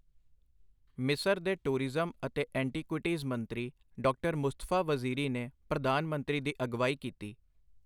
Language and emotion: Punjabi, neutral